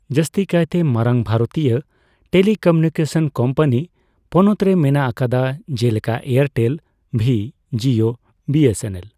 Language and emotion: Santali, neutral